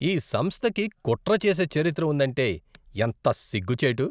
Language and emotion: Telugu, disgusted